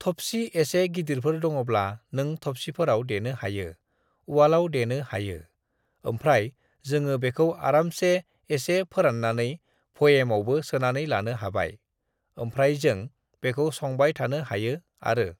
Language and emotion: Bodo, neutral